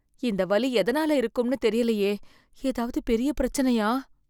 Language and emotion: Tamil, fearful